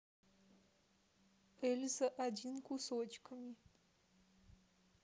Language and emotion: Russian, neutral